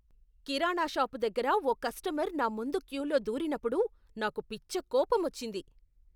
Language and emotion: Telugu, angry